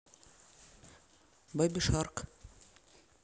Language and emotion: Russian, neutral